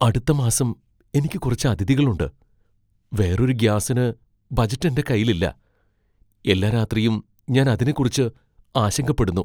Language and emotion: Malayalam, fearful